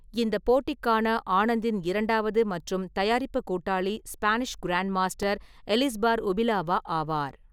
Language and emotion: Tamil, neutral